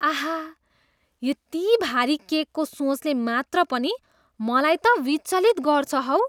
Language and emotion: Nepali, disgusted